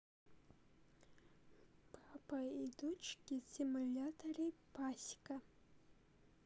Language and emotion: Russian, neutral